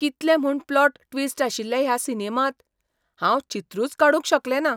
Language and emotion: Goan Konkani, surprised